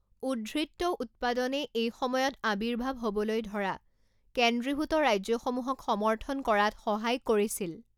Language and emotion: Assamese, neutral